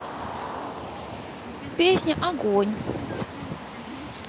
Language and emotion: Russian, neutral